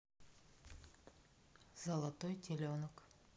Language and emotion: Russian, neutral